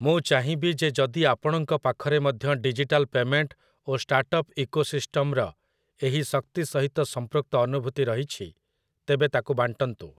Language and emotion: Odia, neutral